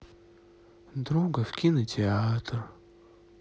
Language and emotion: Russian, sad